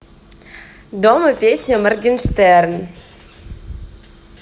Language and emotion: Russian, positive